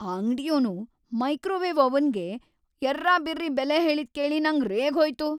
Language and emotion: Kannada, angry